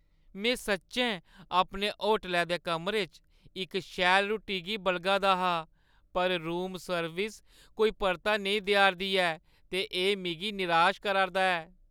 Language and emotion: Dogri, sad